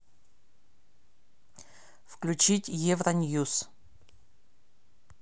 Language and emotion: Russian, neutral